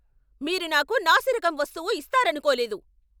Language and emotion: Telugu, angry